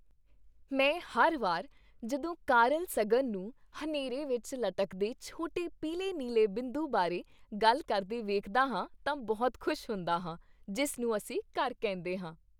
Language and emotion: Punjabi, happy